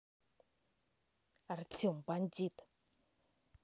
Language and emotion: Russian, angry